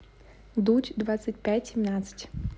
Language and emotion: Russian, neutral